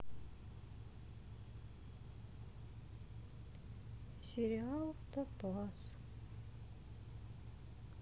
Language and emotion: Russian, sad